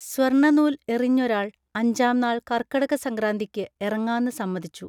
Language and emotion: Malayalam, neutral